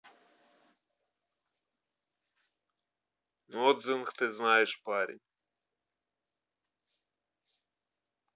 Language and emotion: Russian, neutral